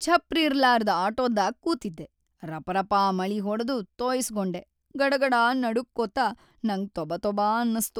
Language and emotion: Kannada, sad